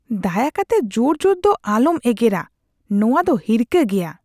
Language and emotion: Santali, disgusted